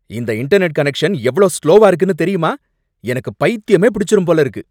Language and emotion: Tamil, angry